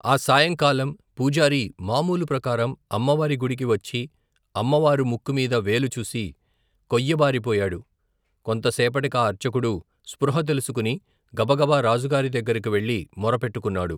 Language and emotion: Telugu, neutral